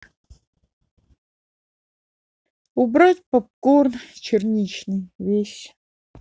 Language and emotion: Russian, neutral